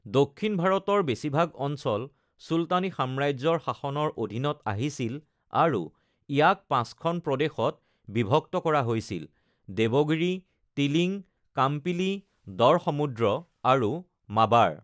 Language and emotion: Assamese, neutral